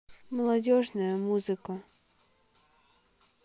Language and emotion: Russian, sad